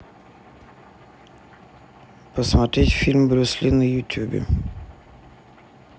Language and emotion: Russian, neutral